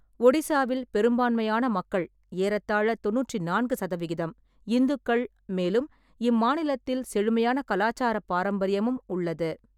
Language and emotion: Tamil, neutral